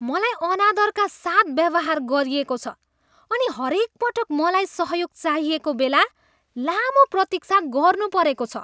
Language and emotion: Nepali, disgusted